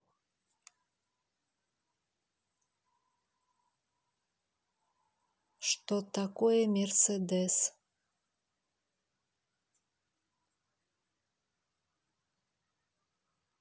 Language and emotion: Russian, neutral